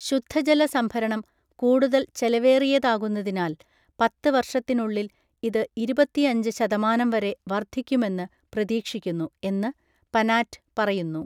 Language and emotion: Malayalam, neutral